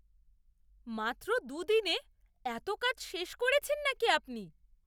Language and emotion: Bengali, surprised